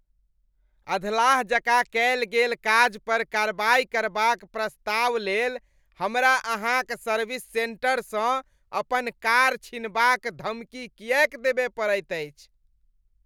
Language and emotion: Maithili, disgusted